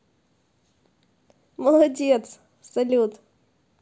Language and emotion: Russian, positive